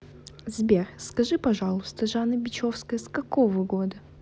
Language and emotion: Russian, neutral